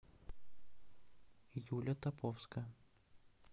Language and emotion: Russian, neutral